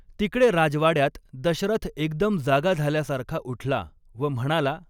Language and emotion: Marathi, neutral